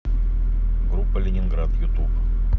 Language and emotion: Russian, neutral